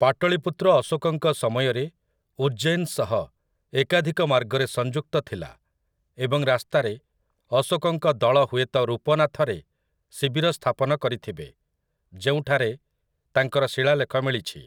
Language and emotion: Odia, neutral